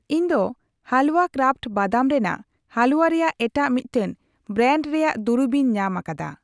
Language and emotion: Santali, neutral